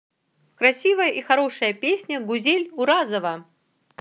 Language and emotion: Russian, positive